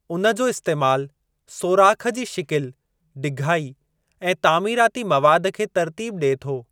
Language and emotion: Sindhi, neutral